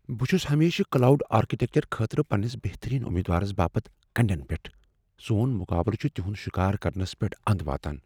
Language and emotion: Kashmiri, fearful